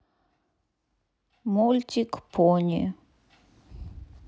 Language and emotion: Russian, neutral